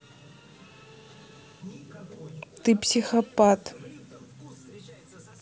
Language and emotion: Russian, neutral